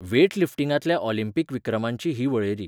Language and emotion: Goan Konkani, neutral